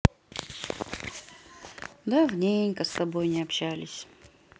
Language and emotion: Russian, sad